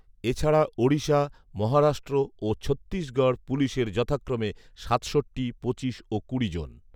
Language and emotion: Bengali, neutral